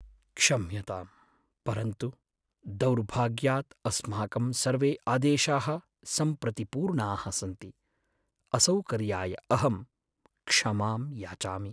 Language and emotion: Sanskrit, sad